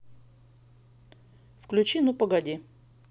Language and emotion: Russian, neutral